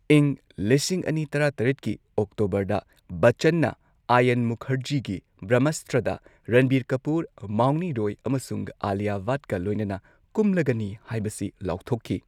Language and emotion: Manipuri, neutral